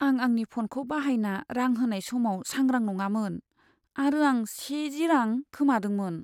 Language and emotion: Bodo, sad